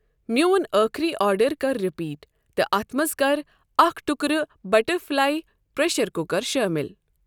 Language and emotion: Kashmiri, neutral